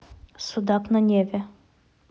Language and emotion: Russian, neutral